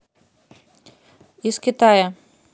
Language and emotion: Russian, neutral